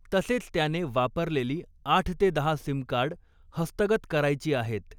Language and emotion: Marathi, neutral